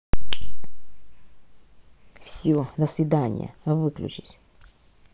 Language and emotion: Russian, angry